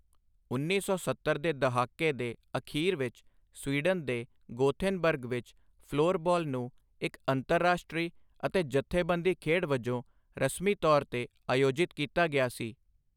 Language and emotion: Punjabi, neutral